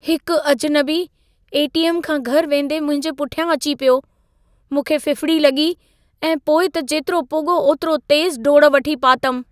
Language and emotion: Sindhi, fearful